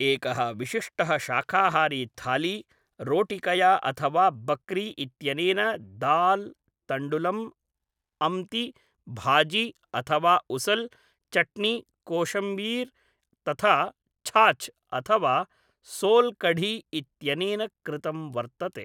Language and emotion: Sanskrit, neutral